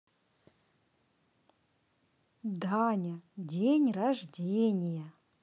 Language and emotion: Russian, positive